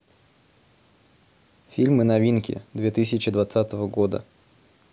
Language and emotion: Russian, neutral